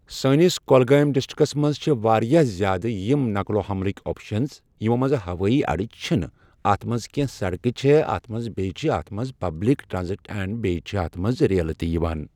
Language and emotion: Kashmiri, neutral